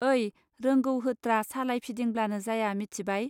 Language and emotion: Bodo, neutral